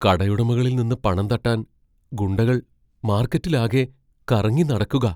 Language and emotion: Malayalam, fearful